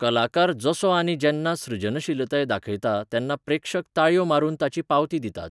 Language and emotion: Goan Konkani, neutral